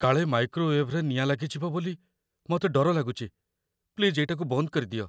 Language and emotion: Odia, fearful